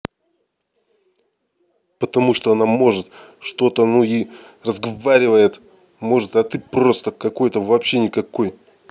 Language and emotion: Russian, angry